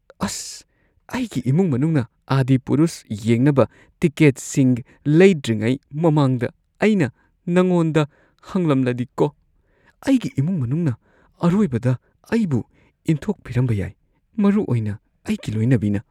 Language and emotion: Manipuri, fearful